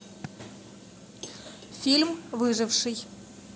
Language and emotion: Russian, neutral